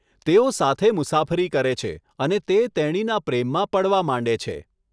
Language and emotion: Gujarati, neutral